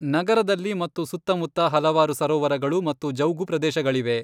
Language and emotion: Kannada, neutral